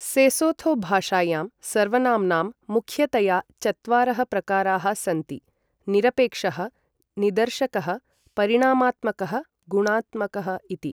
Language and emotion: Sanskrit, neutral